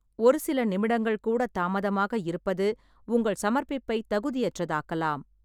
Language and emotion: Tamil, neutral